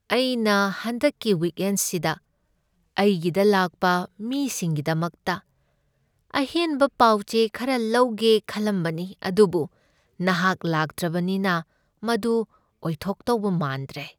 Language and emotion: Manipuri, sad